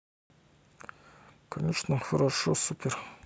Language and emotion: Russian, neutral